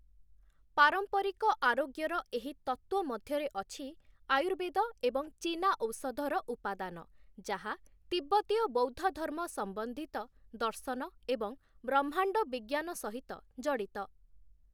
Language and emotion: Odia, neutral